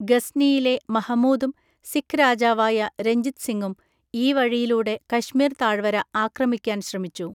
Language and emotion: Malayalam, neutral